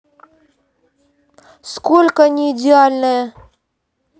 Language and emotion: Russian, angry